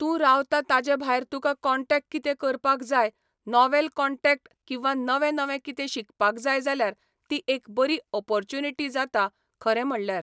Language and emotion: Goan Konkani, neutral